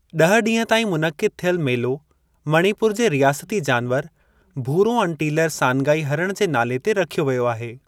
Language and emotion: Sindhi, neutral